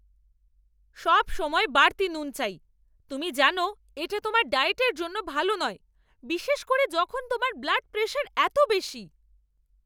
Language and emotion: Bengali, angry